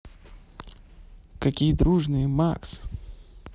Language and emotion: Russian, positive